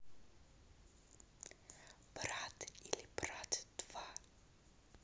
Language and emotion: Russian, neutral